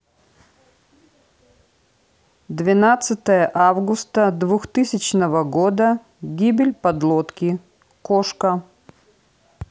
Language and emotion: Russian, neutral